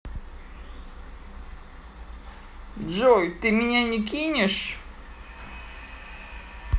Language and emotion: Russian, neutral